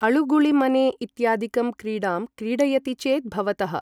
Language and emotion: Sanskrit, neutral